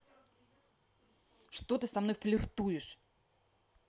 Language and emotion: Russian, angry